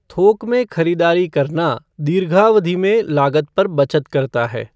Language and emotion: Hindi, neutral